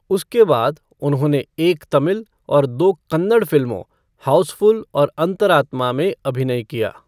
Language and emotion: Hindi, neutral